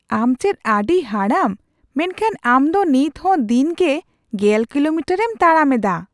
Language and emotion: Santali, surprised